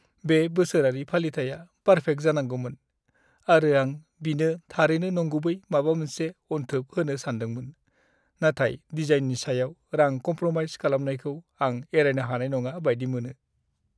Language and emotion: Bodo, sad